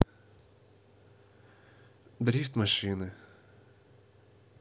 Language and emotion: Russian, sad